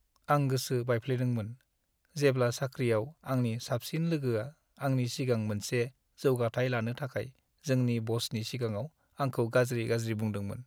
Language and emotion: Bodo, sad